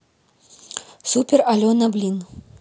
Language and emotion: Russian, neutral